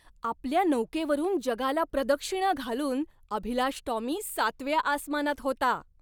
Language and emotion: Marathi, happy